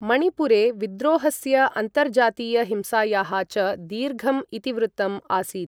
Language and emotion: Sanskrit, neutral